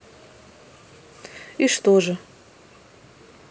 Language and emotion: Russian, neutral